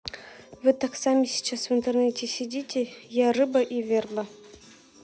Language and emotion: Russian, neutral